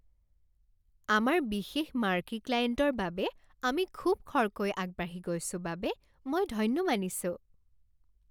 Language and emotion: Assamese, happy